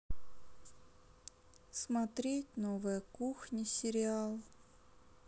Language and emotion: Russian, sad